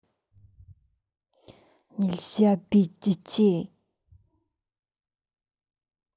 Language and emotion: Russian, angry